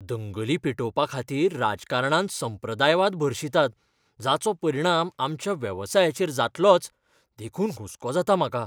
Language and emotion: Goan Konkani, fearful